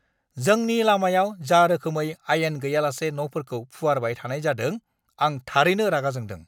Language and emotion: Bodo, angry